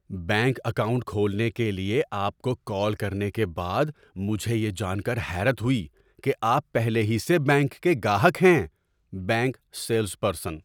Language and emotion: Urdu, surprised